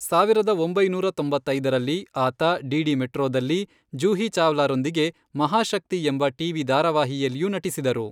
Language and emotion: Kannada, neutral